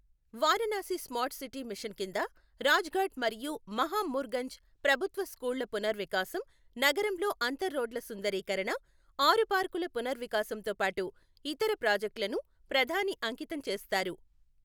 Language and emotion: Telugu, neutral